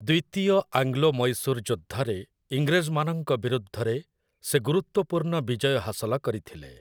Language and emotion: Odia, neutral